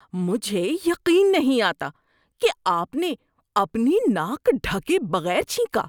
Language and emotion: Urdu, disgusted